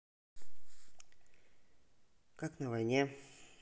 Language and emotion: Russian, neutral